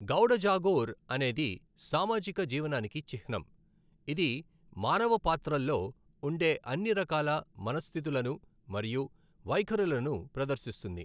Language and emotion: Telugu, neutral